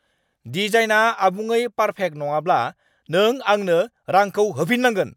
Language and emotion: Bodo, angry